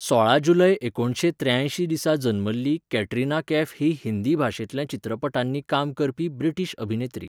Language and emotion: Goan Konkani, neutral